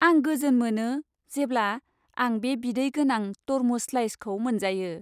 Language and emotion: Bodo, happy